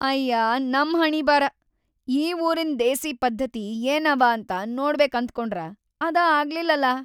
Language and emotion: Kannada, sad